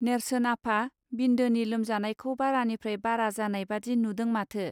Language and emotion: Bodo, neutral